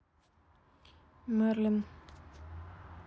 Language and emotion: Russian, neutral